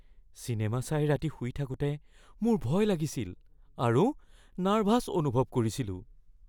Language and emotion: Assamese, fearful